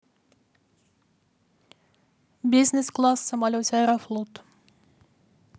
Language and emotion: Russian, neutral